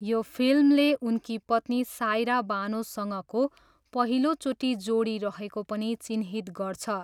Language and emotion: Nepali, neutral